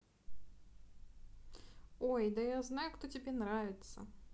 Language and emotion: Russian, neutral